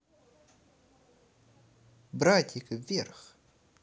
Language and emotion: Russian, positive